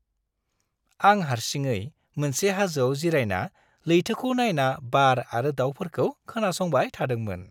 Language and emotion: Bodo, happy